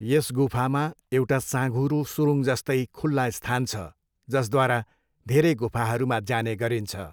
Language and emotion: Nepali, neutral